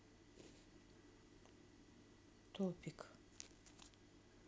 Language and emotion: Russian, neutral